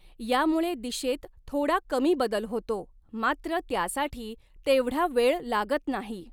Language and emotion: Marathi, neutral